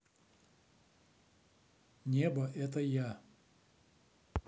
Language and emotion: Russian, neutral